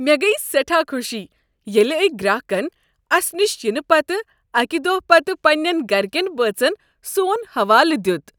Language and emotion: Kashmiri, happy